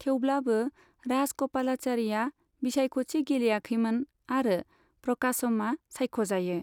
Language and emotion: Bodo, neutral